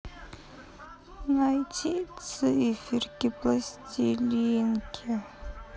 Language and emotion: Russian, sad